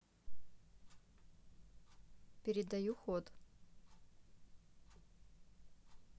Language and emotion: Russian, neutral